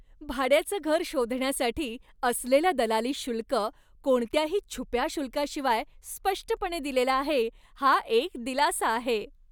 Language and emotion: Marathi, happy